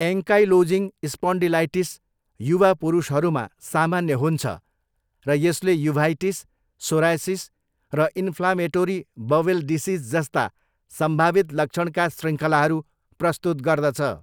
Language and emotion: Nepali, neutral